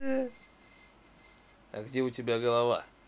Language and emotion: Russian, neutral